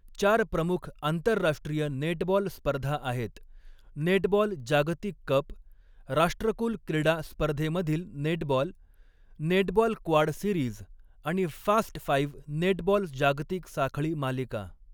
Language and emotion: Marathi, neutral